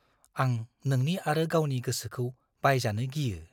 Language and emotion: Bodo, fearful